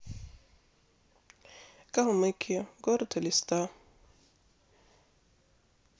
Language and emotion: Russian, neutral